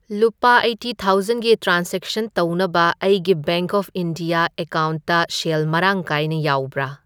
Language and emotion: Manipuri, neutral